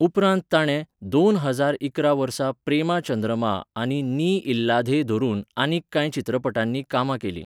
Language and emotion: Goan Konkani, neutral